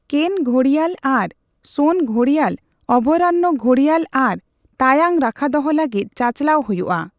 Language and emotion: Santali, neutral